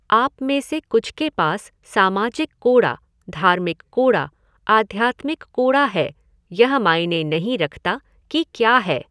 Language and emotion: Hindi, neutral